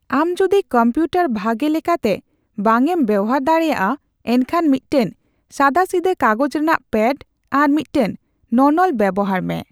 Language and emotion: Santali, neutral